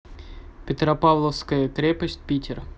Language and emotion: Russian, neutral